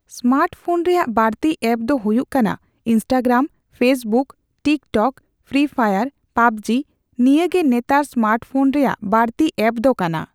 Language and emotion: Santali, neutral